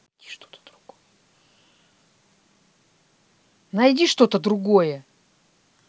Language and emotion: Russian, angry